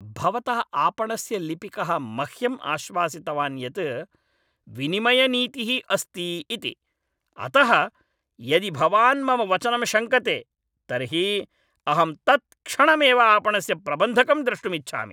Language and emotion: Sanskrit, angry